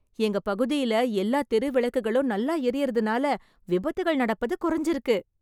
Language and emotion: Tamil, happy